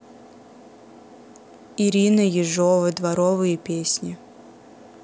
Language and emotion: Russian, neutral